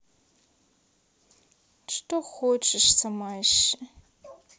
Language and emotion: Russian, neutral